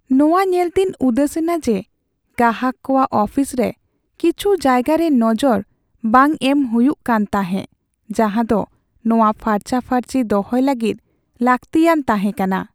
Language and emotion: Santali, sad